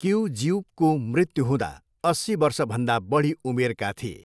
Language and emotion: Nepali, neutral